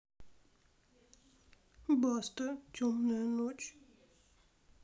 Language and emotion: Russian, neutral